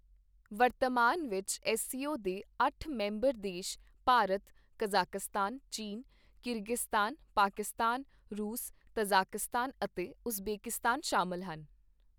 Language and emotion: Punjabi, neutral